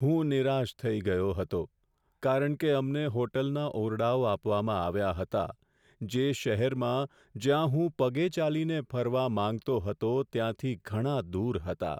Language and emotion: Gujarati, sad